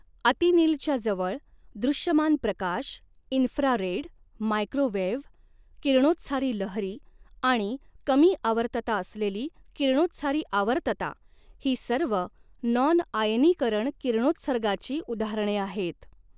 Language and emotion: Marathi, neutral